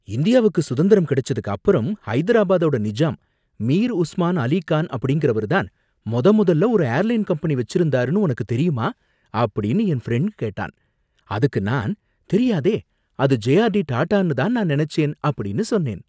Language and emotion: Tamil, surprised